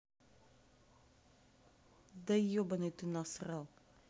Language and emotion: Russian, angry